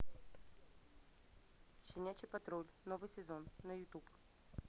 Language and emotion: Russian, neutral